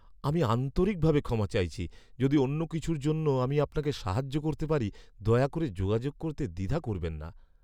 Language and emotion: Bengali, sad